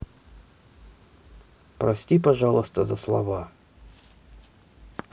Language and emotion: Russian, neutral